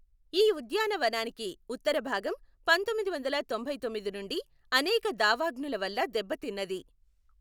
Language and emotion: Telugu, neutral